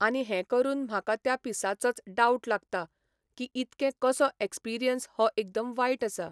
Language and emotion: Goan Konkani, neutral